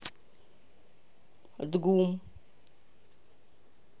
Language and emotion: Russian, neutral